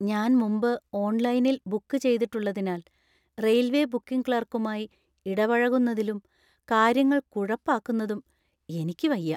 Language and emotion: Malayalam, fearful